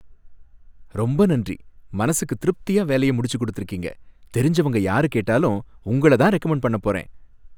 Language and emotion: Tamil, happy